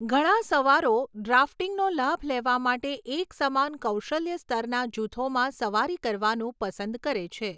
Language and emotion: Gujarati, neutral